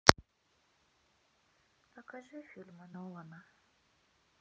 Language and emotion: Russian, sad